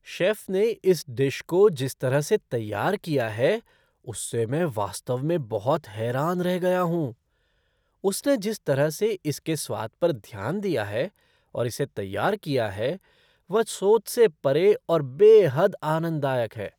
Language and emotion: Hindi, surprised